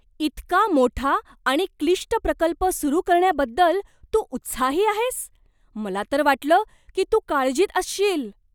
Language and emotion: Marathi, surprised